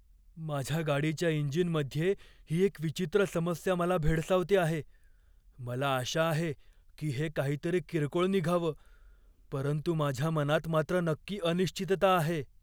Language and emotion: Marathi, fearful